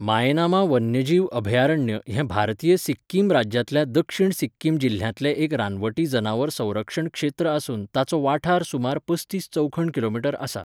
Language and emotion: Goan Konkani, neutral